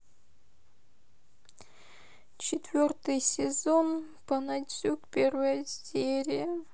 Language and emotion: Russian, sad